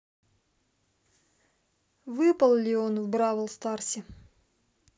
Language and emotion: Russian, neutral